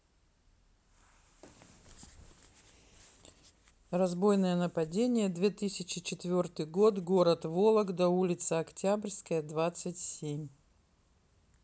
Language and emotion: Russian, neutral